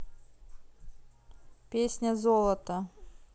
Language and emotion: Russian, neutral